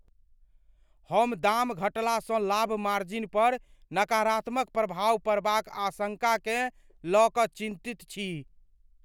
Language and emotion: Maithili, fearful